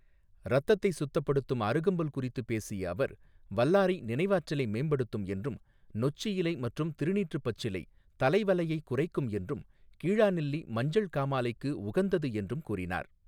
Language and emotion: Tamil, neutral